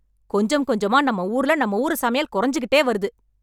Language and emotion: Tamil, angry